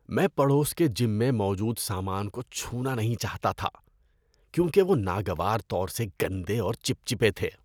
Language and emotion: Urdu, disgusted